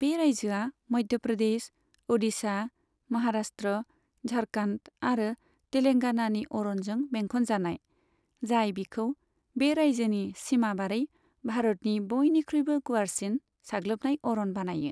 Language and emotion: Bodo, neutral